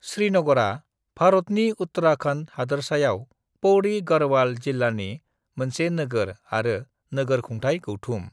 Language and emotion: Bodo, neutral